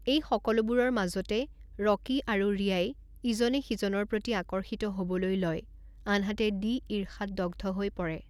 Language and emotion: Assamese, neutral